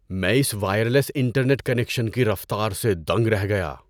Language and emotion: Urdu, surprised